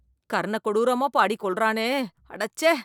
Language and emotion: Tamil, disgusted